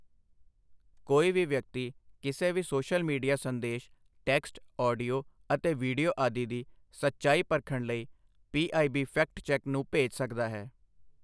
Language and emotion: Punjabi, neutral